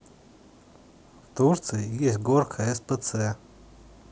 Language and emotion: Russian, neutral